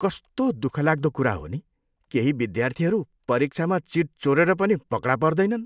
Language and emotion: Nepali, disgusted